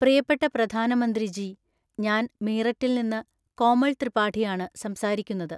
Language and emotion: Malayalam, neutral